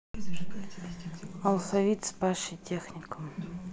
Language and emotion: Russian, sad